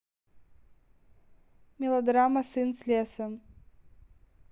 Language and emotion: Russian, neutral